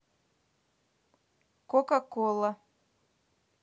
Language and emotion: Russian, neutral